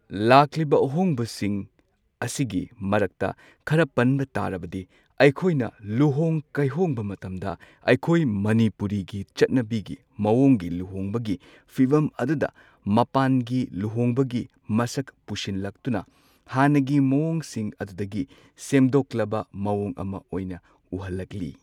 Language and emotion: Manipuri, neutral